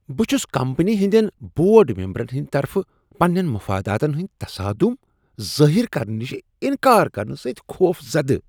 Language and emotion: Kashmiri, disgusted